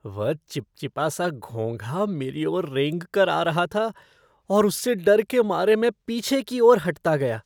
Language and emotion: Hindi, disgusted